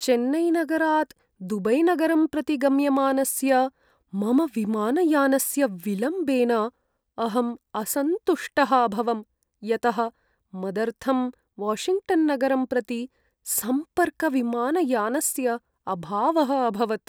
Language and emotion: Sanskrit, sad